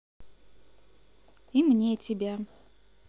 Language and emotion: Russian, positive